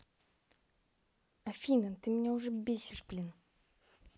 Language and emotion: Russian, angry